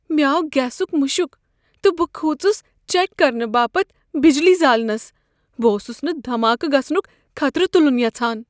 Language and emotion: Kashmiri, fearful